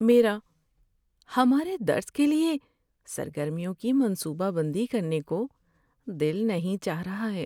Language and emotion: Urdu, sad